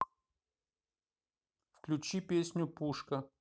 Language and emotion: Russian, neutral